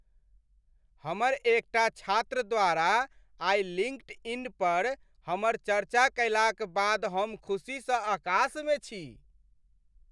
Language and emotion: Maithili, happy